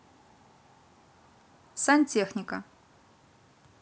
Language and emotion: Russian, neutral